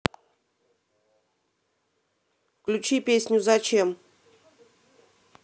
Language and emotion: Russian, neutral